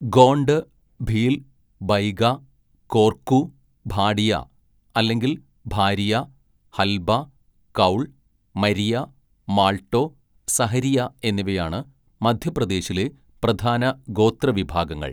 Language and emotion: Malayalam, neutral